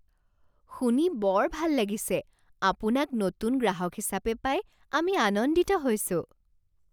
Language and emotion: Assamese, surprised